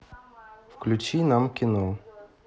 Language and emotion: Russian, neutral